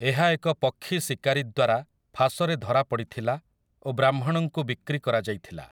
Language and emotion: Odia, neutral